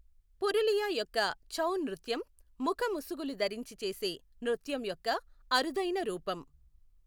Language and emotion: Telugu, neutral